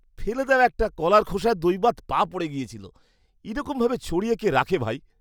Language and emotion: Bengali, disgusted